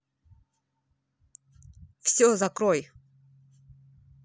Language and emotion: Russian, angry